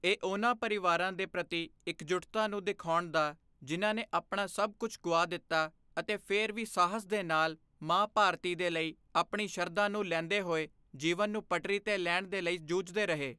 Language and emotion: Punjabi, neutral